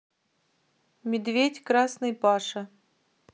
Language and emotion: Russian, neutral